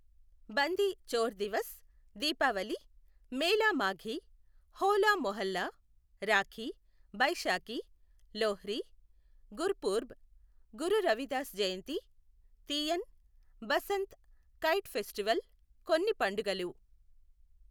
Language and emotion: Telugu, neutral